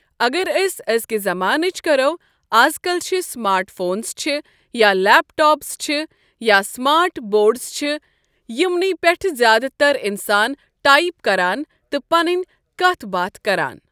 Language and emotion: Kashmiri, neutral